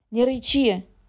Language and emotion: Russian, angry